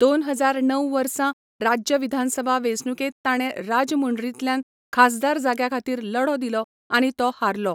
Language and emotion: Goan Konkani, neutral